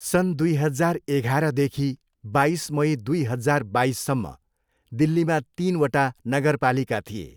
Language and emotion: Nepali, neutral